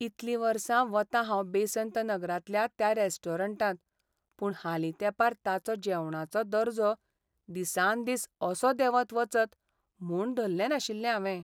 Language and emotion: Goan Konkani, sad